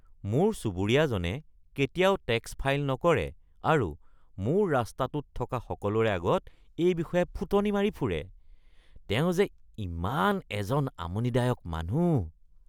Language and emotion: Assamese, disgusted